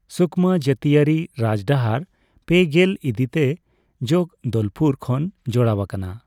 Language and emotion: Santali, neutral